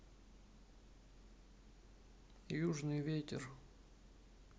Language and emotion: Russian, neutral